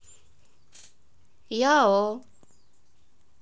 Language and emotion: Russian, neutral